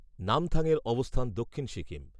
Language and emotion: Bengali, neutral